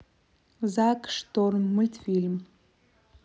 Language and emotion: Russian, neutral